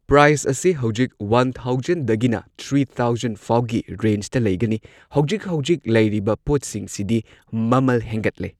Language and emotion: Manipuri, neutral